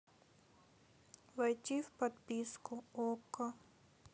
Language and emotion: Russian, sad